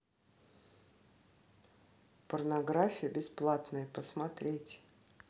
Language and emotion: Russian, neutral